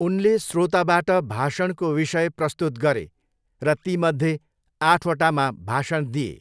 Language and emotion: Nepali, neutral